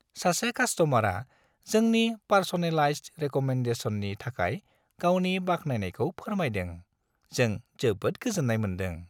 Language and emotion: Bodo, happy